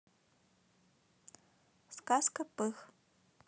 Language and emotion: Russian, neutral